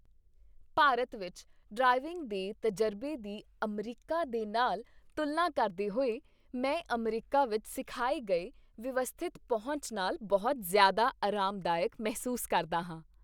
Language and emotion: Punjabi, happy